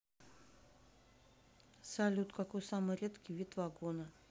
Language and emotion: Russian, neutral